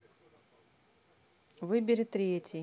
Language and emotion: Russian, neutral